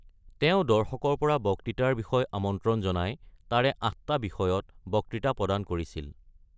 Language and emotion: Assamese, neutral